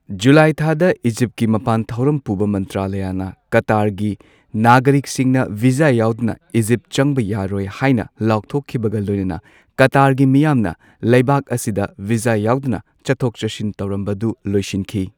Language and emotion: Manipuri, neutral